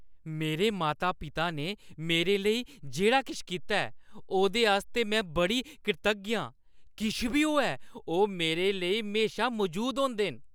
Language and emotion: Dogri, happy